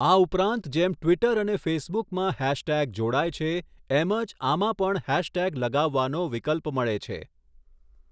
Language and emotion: Gujarati, neutral